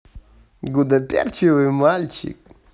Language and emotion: Russian, positive